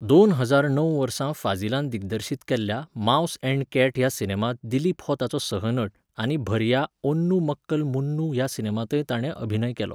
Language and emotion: Goan Konkani, neutral